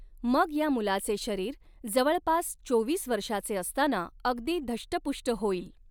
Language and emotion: Marathi, neutral